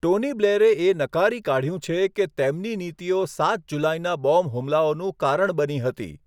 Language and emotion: Gujarati, neutral